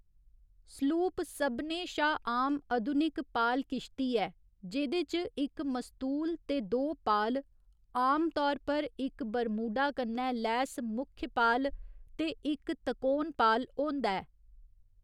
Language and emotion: Dogri, neutral